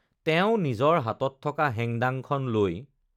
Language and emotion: Assamese, neutral